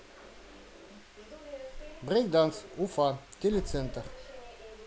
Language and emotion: Russian, positive